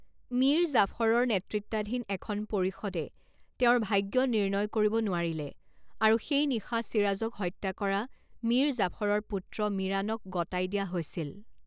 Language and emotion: Assamese, neutral